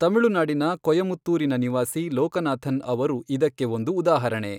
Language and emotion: Kannada, neutral